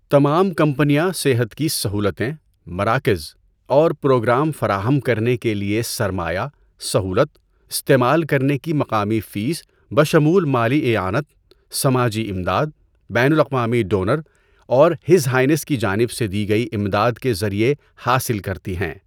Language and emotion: Urdu, neutral